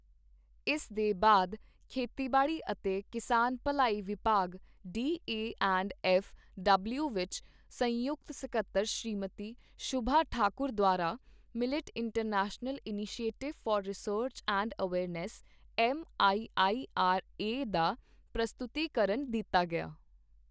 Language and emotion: Punjabi, neutral